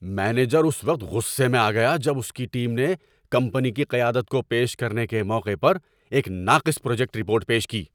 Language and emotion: Urdu, angry